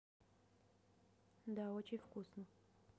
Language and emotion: Russian, neutral